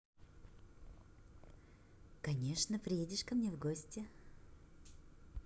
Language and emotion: Russian, positive